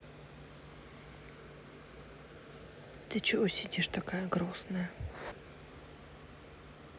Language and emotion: Russian, sad